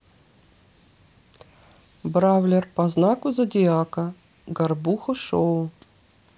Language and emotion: Russian, neutral